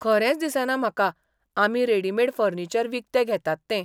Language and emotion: Goan Konkani, surprised